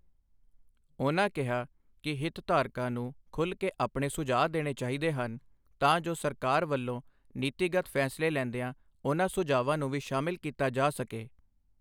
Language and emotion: Punjabi, neutral